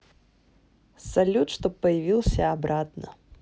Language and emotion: Russian, neutral